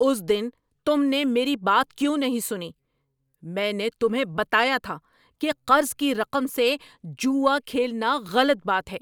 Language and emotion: Urdu, angry